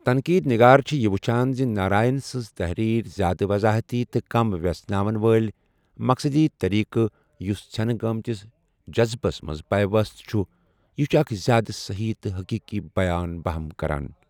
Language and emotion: Kashmiri, neutral